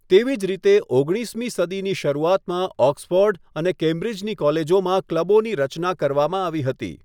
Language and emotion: Gujarati, neutral